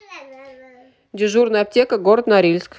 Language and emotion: Russian, neutral